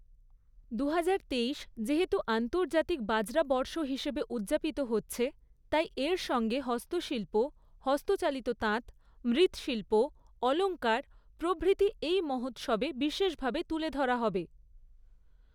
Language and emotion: Bengali, neutral